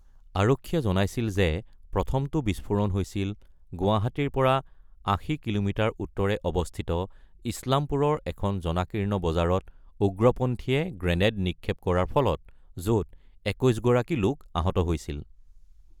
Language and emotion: Assamese, neutral